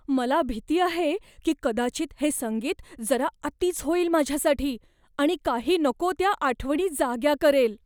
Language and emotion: Marathi, fearful